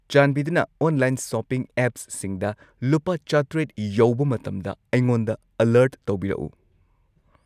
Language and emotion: Manipuri, neutral